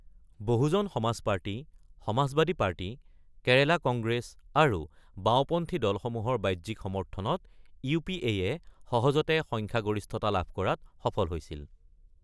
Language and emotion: Assamese, neutral